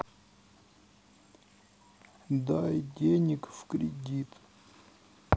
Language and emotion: Russian, sad